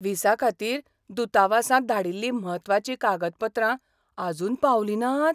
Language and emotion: Goan Konkani, surprised